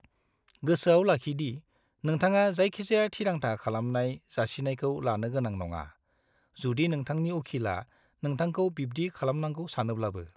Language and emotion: Bodo, neutral